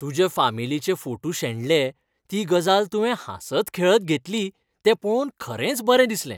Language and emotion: Goan Konkani, happy